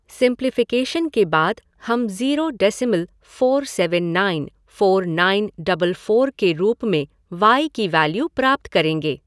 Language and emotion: Hindi, neutral